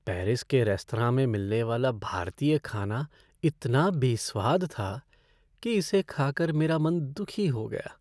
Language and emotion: Hindi, sad